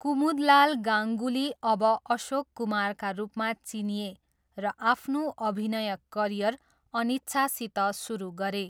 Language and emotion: Nepali, neutral